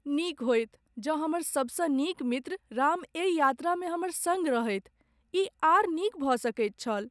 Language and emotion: Maithili, sad